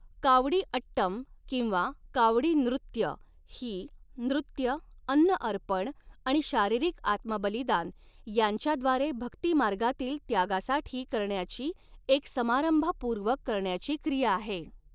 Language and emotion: Marathi, neutral